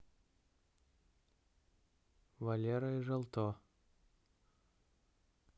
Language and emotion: Russian, neutral